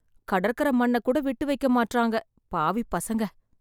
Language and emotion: Tamil, sad